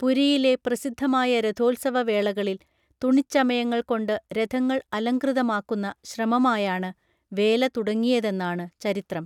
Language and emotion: Malayalam, neutral